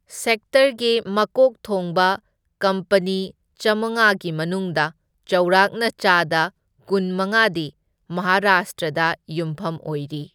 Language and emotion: Manipuri, neutral